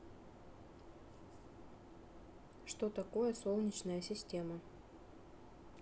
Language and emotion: Russian, neutral